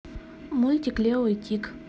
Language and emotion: Russian, neutral